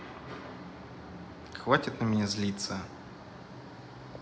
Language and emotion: Russian, neutral